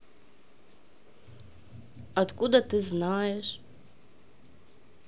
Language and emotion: Russian, neutral